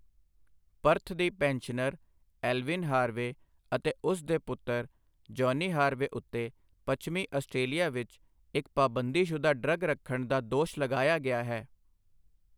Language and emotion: Punjabi, neutral